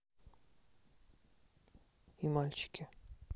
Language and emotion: Russian, neutral